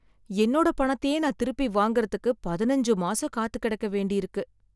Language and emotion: Tamil, sad